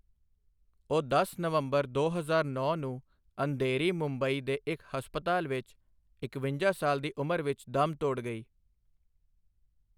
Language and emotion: Punjabi, neutral